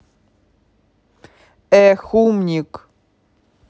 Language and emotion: Russian, angry